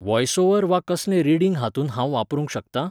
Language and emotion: Goan Konkani, neutral